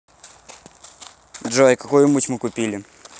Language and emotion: Russian, neutral